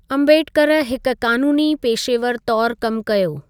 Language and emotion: Sindhi, neutral